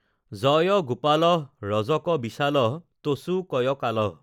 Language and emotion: Assamese, neutral